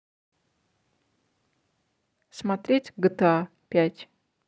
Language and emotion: Russian, neutral